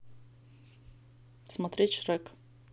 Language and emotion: Russian, neutral